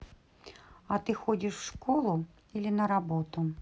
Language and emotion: Russian, neutral